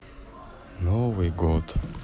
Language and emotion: Russian, sad